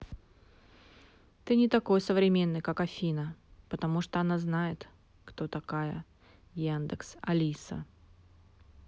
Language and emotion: Russian, neutral